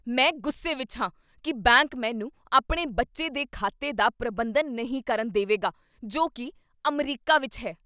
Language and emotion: Punjabi, angry